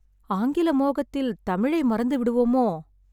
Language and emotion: Tamil, sad